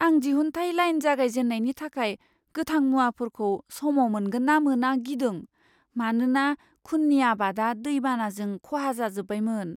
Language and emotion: Bodo, fearful